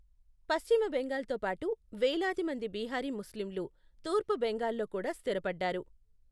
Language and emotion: Telugu, neutral